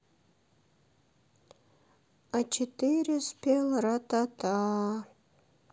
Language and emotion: Russian, sad